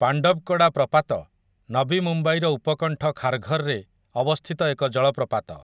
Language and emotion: Odia, neutral